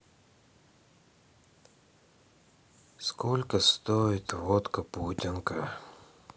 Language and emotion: Russian, sad